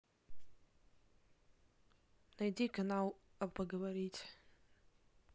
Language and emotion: Russian, neutral